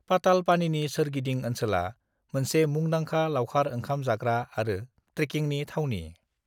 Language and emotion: Bodo, neutral